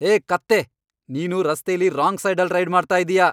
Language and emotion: Kannada, angry